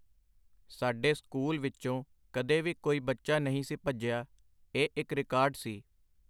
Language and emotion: Punjabi, neutral